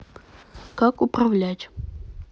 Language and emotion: Russian, neutral